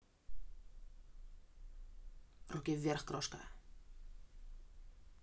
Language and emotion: Russian, neutral